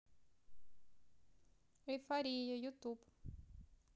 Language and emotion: Russian, neutral